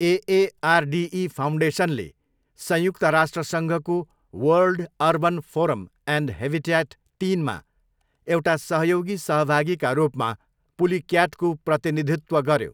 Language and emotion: Nepali, neutral